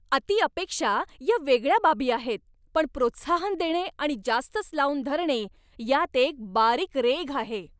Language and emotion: Marathi, angry